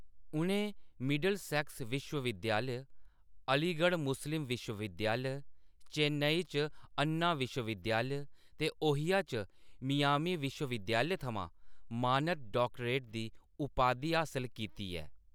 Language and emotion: Dogri, neutral